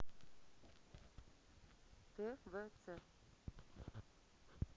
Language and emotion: Russian, neutral